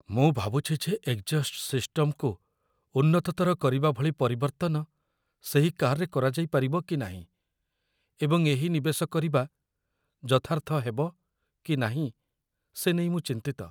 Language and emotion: Odia, fearful